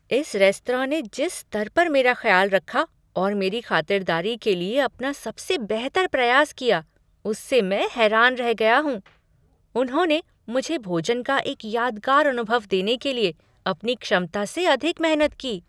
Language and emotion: Hindi, surprised